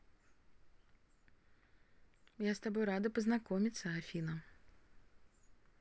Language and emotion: Russian, positive